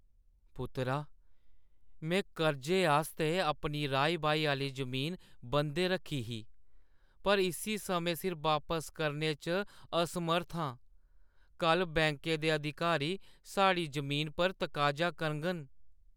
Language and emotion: Dogri, sad